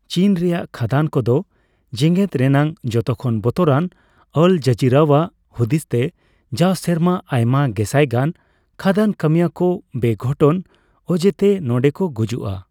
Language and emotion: Santali, neutral